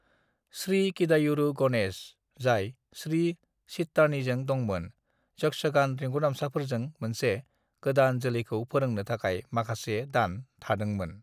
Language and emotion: Bodo, neutral